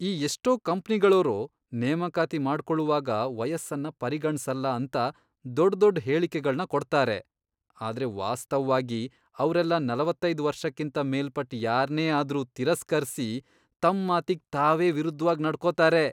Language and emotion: Kannada, disgusted